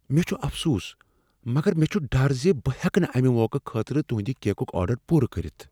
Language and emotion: Kashmiri, fearful